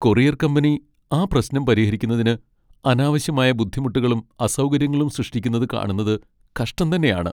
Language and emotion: Malayalam, sad